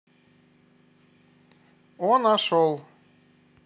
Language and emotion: Russian, positive